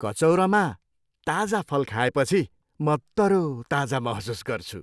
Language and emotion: Nepali, happy